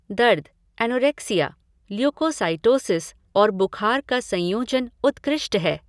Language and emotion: Hindi, neutral